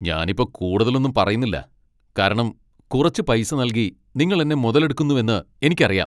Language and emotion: Malayalam, angry